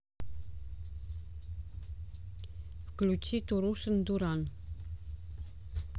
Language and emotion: Russian, neutral